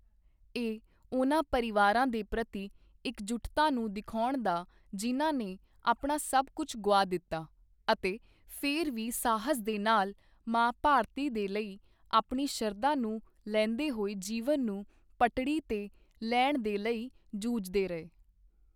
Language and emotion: Punjabi, neutral